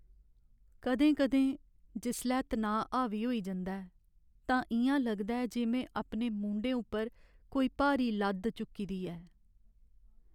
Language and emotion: Dogri, sad